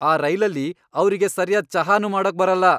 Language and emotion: Kannada, angry